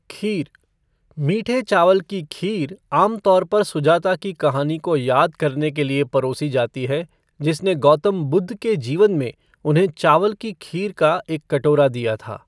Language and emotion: Hindi, neutral